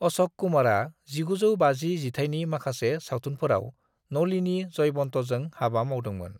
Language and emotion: Bodo, neutral